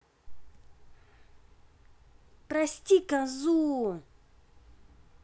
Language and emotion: Russian, angry